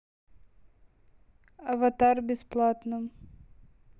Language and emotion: Russian, neutral